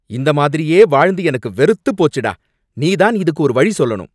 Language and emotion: Tamil, angry